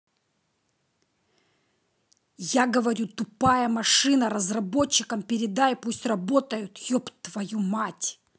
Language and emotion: Russian, angry